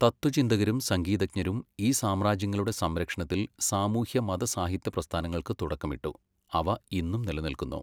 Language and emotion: Malayalam, neutral